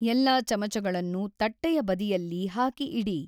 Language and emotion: Kannada, neutral